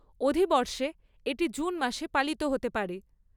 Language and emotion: Bengali, neutral